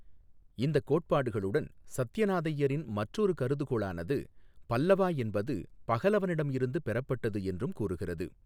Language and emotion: Tamil, neutral